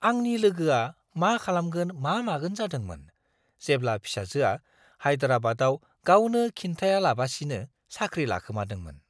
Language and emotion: Bodo, surprised